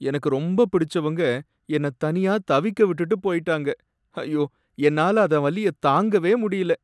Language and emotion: Tamil, sad